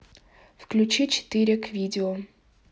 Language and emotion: Russian, neutral